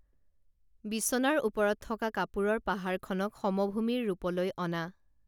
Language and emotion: Assamese, neutral